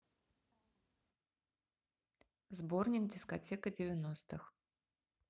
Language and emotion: Russian, neutral